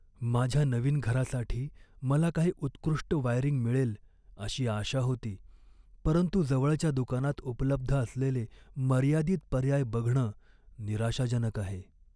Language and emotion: Marathi, sad